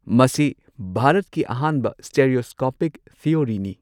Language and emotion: Manipuri, neutral